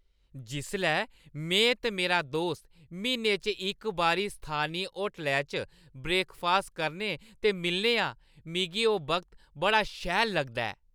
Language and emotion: Dogri, happy